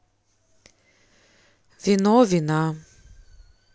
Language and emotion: Russian, neutral